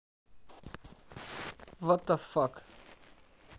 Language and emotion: Russian, neutral